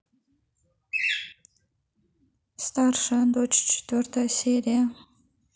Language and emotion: Russian, neutral